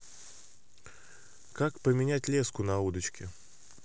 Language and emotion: Russian, neutral